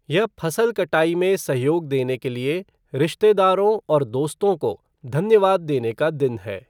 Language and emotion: Hindi, neutral